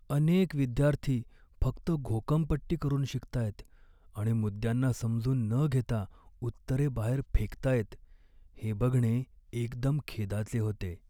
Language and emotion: Marathi, sad